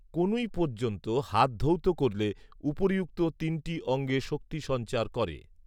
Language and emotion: Bengali, neutral